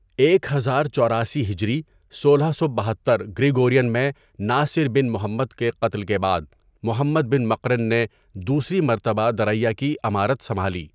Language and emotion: Urdu, neutral